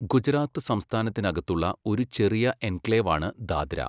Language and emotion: Malayalam, neutral